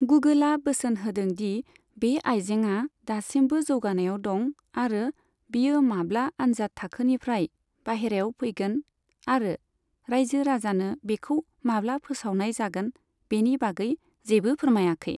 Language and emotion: Bodo, neutral